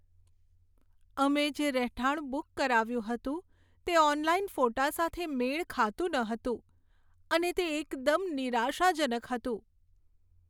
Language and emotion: Gujarati, sad